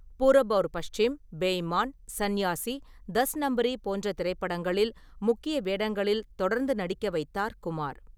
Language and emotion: Tamil, neutral